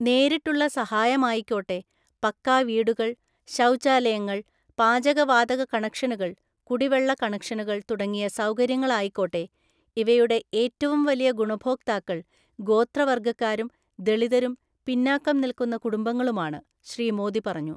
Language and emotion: Malayalam, neutral